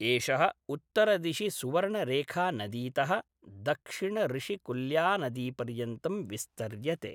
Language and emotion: Sanskrit, neutral